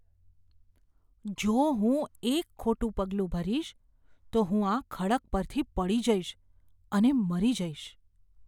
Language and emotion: Gujarati, fearful